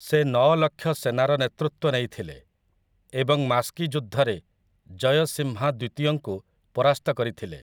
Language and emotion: Odia, neutral